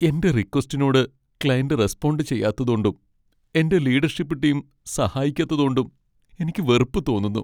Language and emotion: Malayalam, sad